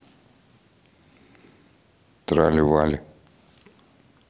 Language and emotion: Russian, neutral